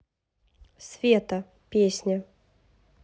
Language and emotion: Russian, neutral